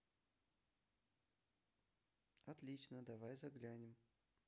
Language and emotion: Russian, neutral